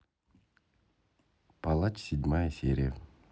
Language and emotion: Russian, neutral